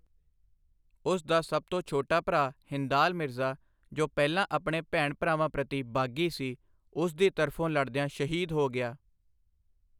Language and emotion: Punjabi, neutral